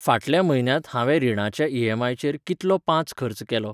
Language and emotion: Goan Konkani, neutral